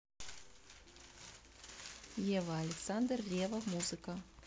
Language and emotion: Russian, neutral